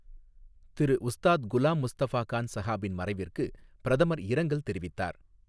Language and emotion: Tamil, neutral